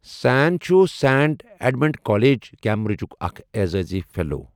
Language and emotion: Kashmiri, neutral